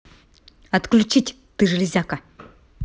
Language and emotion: Russian, angry